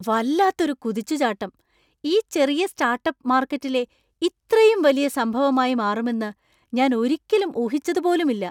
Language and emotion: Malayalam, surprised